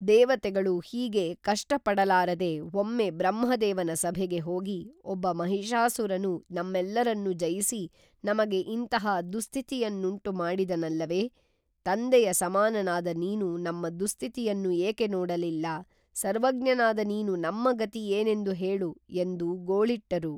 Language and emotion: Kannada, neutral